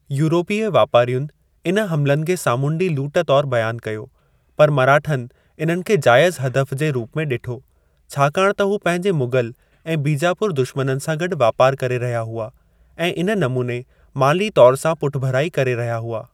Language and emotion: Sindhi, neutral